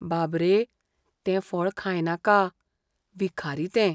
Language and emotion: Goan Konkani, fearful